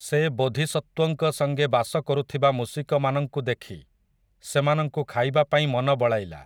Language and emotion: Odia, neutral